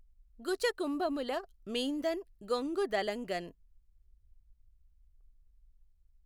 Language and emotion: Telugu, neutral